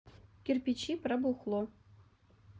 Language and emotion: Russian, neutral